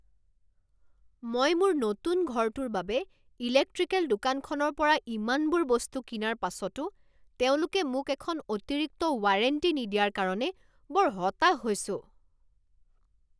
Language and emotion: Assamese, angry